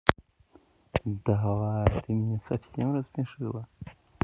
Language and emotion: Russian, positive